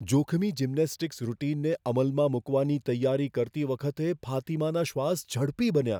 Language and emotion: Gujarati, fearful